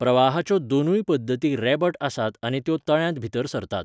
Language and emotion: Goan Konkani, neutral